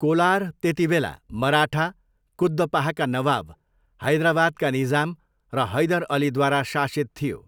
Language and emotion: Nepali, neutral